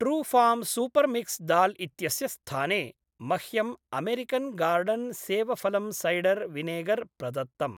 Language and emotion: Sanskrit, neutral